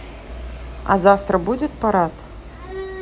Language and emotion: Russian, neutral